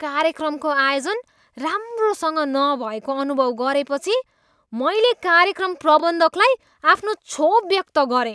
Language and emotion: Nepali, disgusted